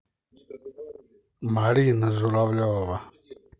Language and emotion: Russian, neutral